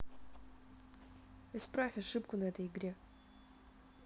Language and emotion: Russian, neutral